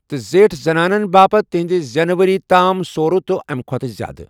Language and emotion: Kashmiri, neutral